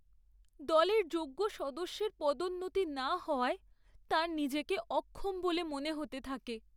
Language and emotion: Bengali, sad